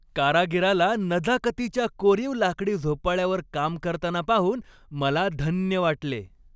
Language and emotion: Marathi, happy